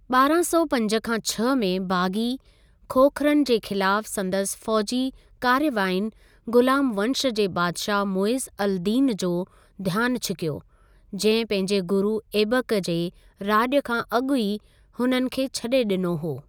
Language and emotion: Sindhi, neutral